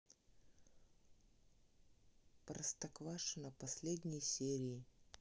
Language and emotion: Russian, neutral